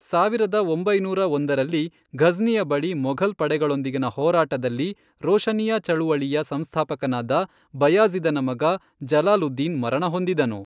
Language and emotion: Kannada, neutral